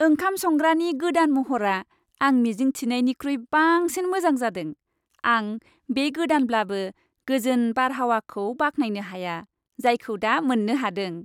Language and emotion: Bodo, happy